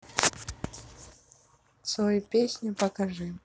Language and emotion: Russian, neutral